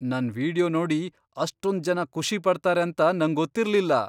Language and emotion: Kannada, surprised